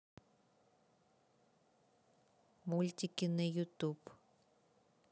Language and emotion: Russian, neutral